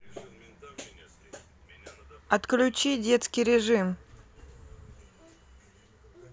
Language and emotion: Russian, neutral